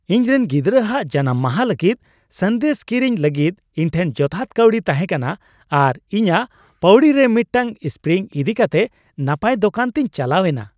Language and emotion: Santali, happy